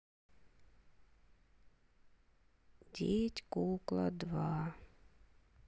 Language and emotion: Russian, neutral